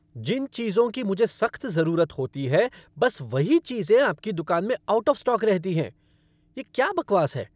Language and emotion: Hindi, angry